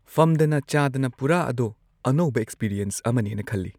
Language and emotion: Manipuri, neutral